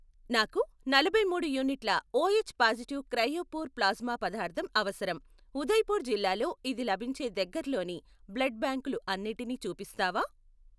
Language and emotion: Telugu, neutral